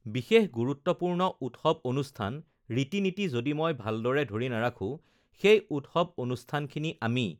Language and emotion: Assamese, neutral